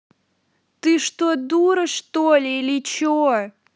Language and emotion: Russian, angry